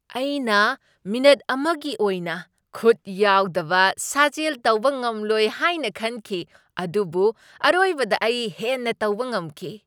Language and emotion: Manipuri, surprised